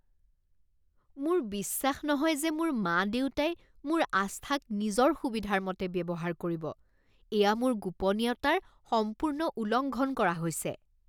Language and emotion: Assamese, disgusted